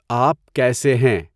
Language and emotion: Urdu, neutral